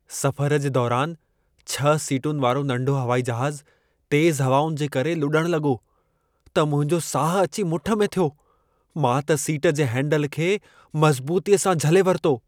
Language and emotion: Sindhi, fearful